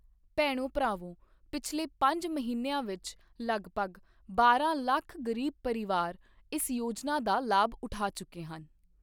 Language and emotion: Punjabi, neutral